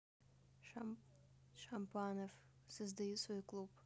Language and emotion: Russian, neutral